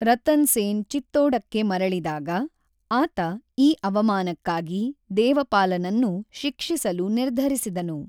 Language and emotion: Kannada, neutral